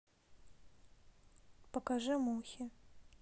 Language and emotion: Russian, neutral